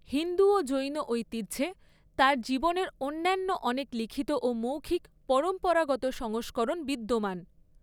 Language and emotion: Bengali, neutral